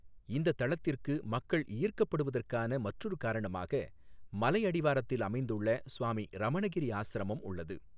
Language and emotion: Tamil, neutral